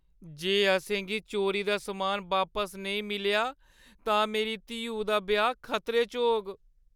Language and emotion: Dogri, fearful